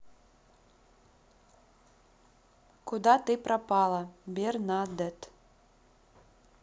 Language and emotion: Russian, neutral